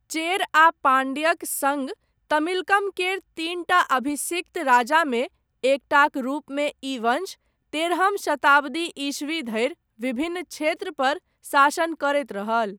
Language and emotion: Maithili, neutral